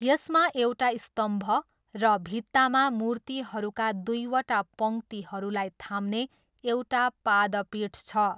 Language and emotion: Nepali, neutral